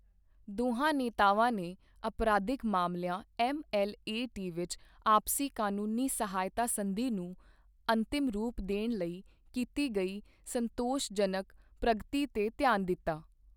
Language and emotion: Punjabi, neutral